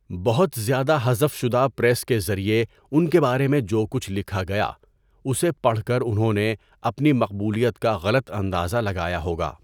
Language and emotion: Urdu, neutral